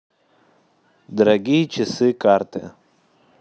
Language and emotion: Russian, neutral